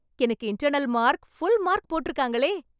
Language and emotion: Tamil, happy